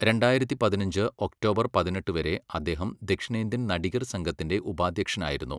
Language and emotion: Malayalam, neutral